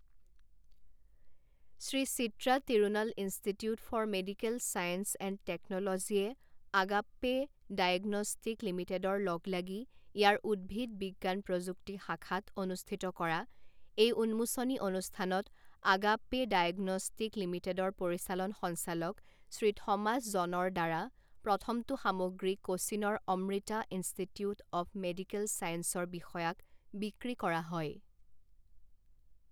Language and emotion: Assamese, neutral